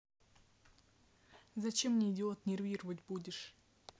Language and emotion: Russian, angry